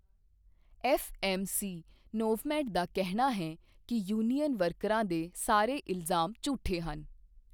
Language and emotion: Punjabi, neutral